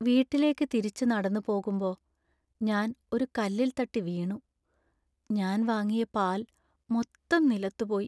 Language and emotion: Malayalam, sad